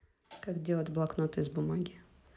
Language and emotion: Russian, neutral